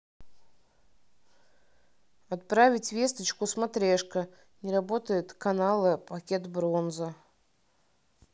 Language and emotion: Russian, neutral